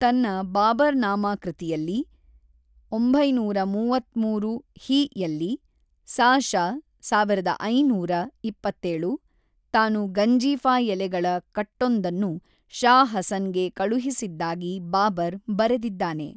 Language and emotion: Kannada, neutral